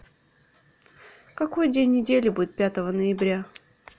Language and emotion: Russian, neutral